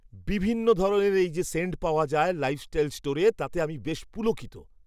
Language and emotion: Bengali, surprised